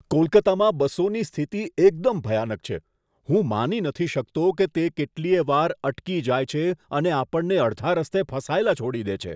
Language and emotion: Gujarati, disgusted